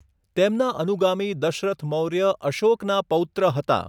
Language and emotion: Gujarati, neutral